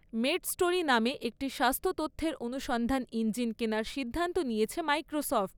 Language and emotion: Bengali, neutral